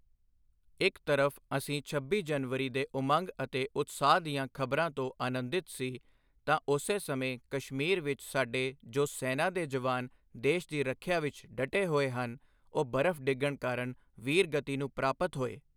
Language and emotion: Punjabi, neutral